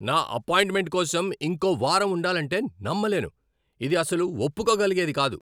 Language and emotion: Telugu, angry